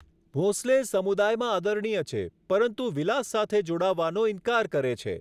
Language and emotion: Gujarati, neutral